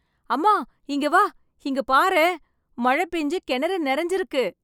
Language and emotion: Tamil, happy